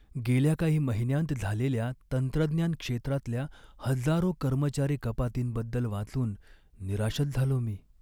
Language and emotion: Marathi, sad